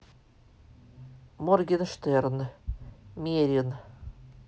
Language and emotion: Russian, neutral